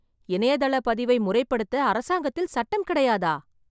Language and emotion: Tamil, surprised